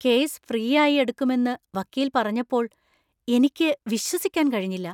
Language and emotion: Malayalam, surprised